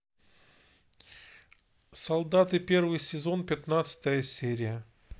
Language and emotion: Russian, neutral